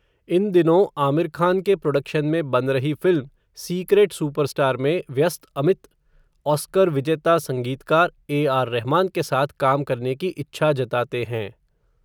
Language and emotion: Hindi, neutral